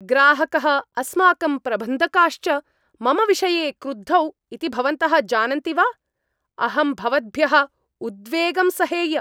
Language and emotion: Sanskrit, angry